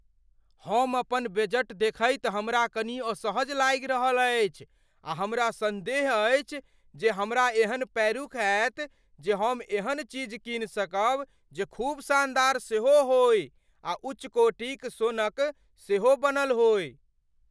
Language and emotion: Maithili, fearful